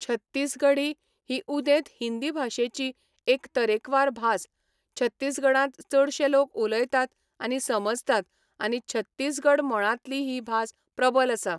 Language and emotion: Goan Konkani, neutral